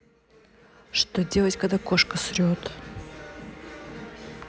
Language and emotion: Russian, neutral